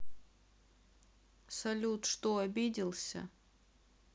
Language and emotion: Russian, sad